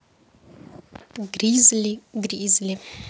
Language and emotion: Russian, neutral